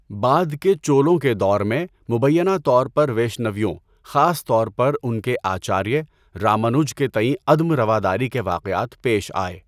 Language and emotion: Urdu, neutral